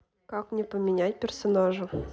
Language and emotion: Russian, neutral